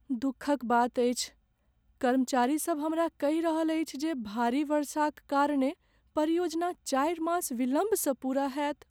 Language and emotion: Maithili, sad